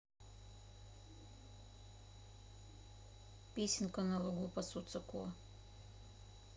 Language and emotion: Russian, neutral